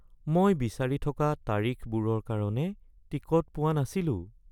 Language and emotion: Assamese, sad